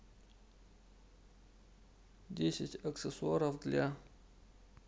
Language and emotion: Russian, neutral